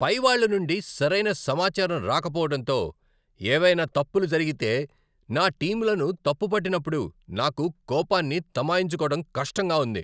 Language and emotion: Telugu, angry